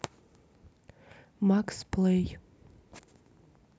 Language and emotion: Russian, neutral